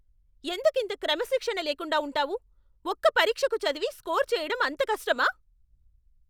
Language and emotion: Telugu, angry